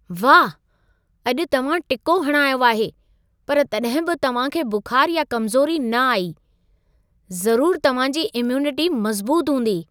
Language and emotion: Sindhi, surprised